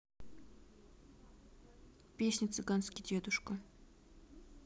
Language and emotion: Russian, neutral